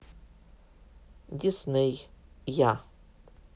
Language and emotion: Russian, neutral